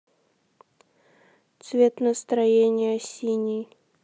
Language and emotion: Russian, sad